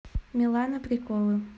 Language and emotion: Russian, neutral